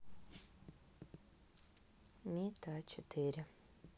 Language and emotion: Russian, sad